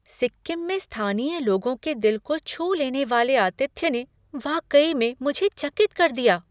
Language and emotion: Hindi, surprised